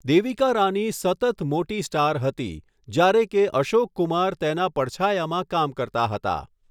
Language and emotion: Gujarati, neutral